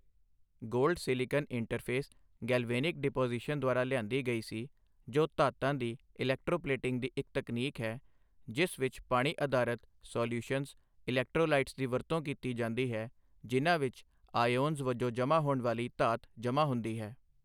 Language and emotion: Punjabi, neutral